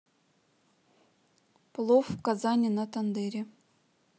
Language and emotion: Russian, neutral